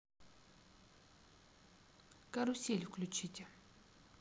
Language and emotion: Russian, neutral